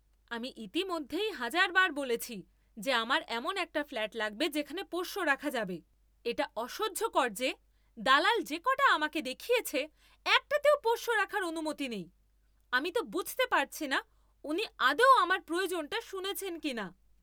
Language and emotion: Bengali, angry